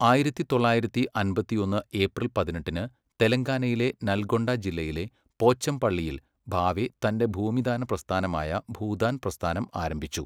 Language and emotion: Malayalam, neutral